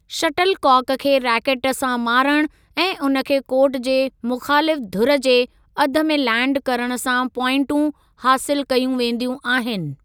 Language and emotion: Sindhi, neutral